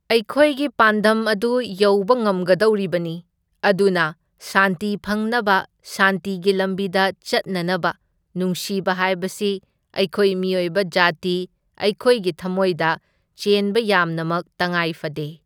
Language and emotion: Manipuri, neutral